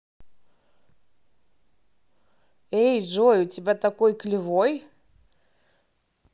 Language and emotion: Russian, neutral